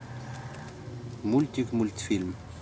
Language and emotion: Russian, neutral